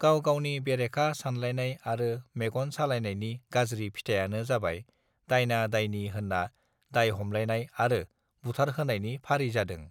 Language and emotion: Bodo, neutral